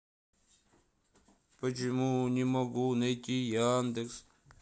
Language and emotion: Russian, sad